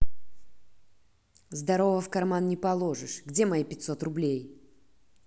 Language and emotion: Russian, angry